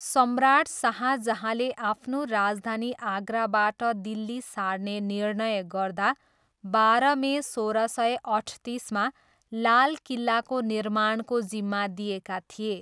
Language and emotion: Nepali, neutral